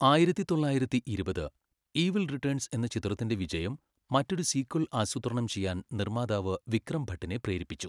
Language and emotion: Malayalam, neutral